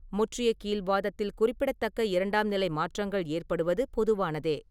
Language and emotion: Tamil, neutral